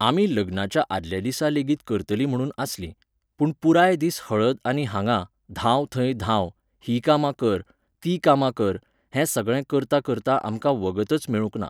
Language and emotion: Goan Konkani, neutral